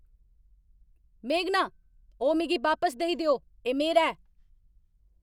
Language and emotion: Dogri, angry